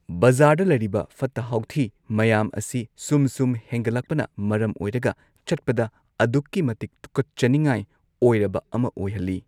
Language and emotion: Manipuri, neutral